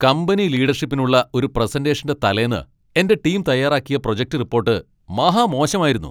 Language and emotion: Malayalam, angry